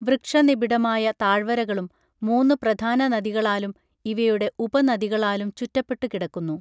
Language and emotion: Malayalam, neutral